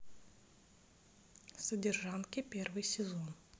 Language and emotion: Russian, neutral